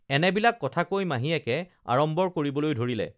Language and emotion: Assamese, neutral